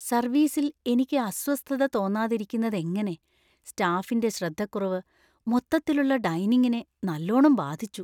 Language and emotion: Malayalam, fearful